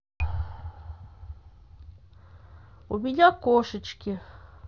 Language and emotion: Russian, neutral